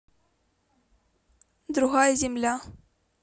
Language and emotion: Russian, neutral